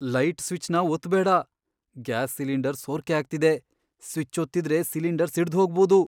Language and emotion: Kannada, fearful